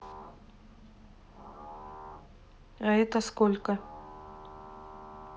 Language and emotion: Russian, neutral